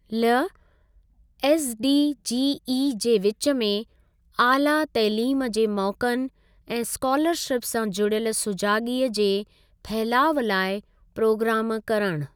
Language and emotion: Sindhi, neutral